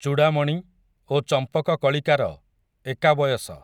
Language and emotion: Odia, neutral